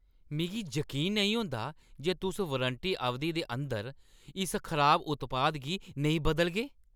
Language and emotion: Dogri, angry